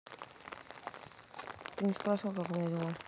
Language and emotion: Russian, neutral